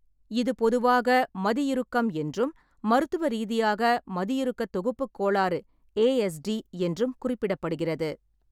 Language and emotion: Tamil, neutral